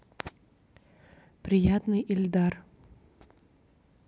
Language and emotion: Russian, neutral